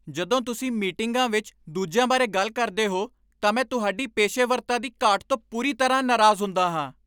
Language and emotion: Punjabi, angry